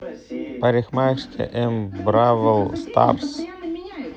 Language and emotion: Russian, neutral